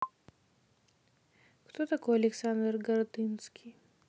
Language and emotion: Russian, neutral